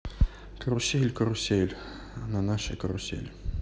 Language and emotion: Russian, neutral